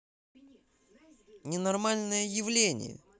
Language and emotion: Russian, angry